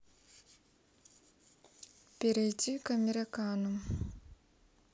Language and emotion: Russian, neutral